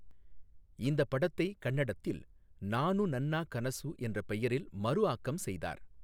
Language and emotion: Tamil, neutral